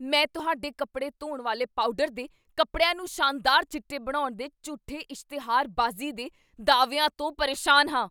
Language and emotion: Punjabi, angry